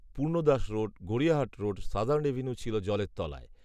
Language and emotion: Bengali, neutral